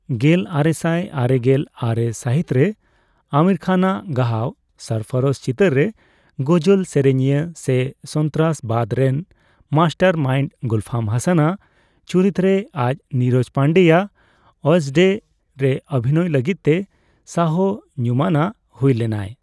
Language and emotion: Santali, neutral